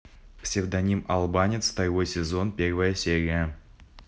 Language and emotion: Russian, neutral